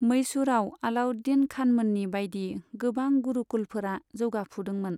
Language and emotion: Bodo, neutral